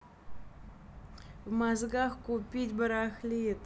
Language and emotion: Russian, angry